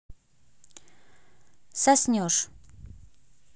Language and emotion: Russian, neutral